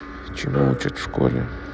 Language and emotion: Russian, neutral